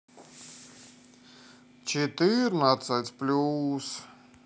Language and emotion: Russian, sad